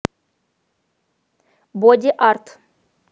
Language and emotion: Russian, positive